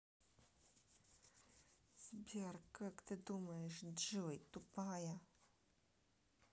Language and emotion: Russian, neutral